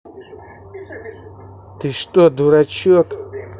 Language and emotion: Russian, angry